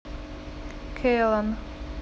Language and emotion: Russian, neutral